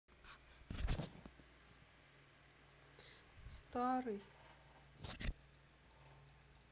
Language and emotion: Russian, sad